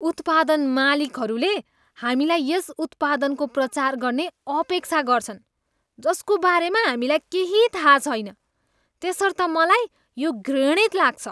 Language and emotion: Nepali, disgusted